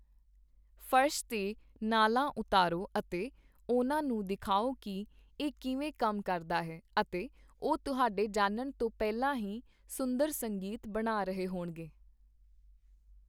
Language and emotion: Punjabi, neutral